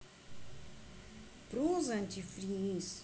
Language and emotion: Russian, neutral